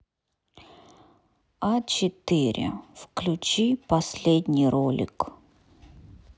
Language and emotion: Russian, neutral